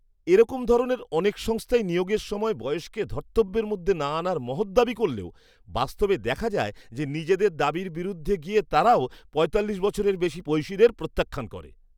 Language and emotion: Bengali, disgusted